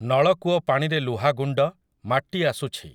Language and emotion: Odia, neutral